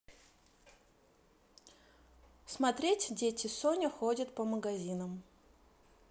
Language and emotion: Russian, neutral